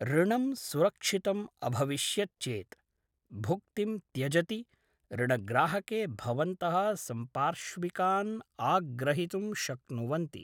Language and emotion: Sanskrit, neutral